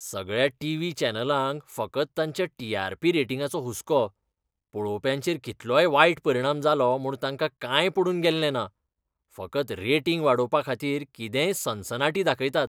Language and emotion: Goan Konkani, disgusted